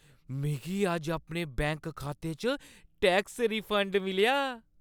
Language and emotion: Dogri, happy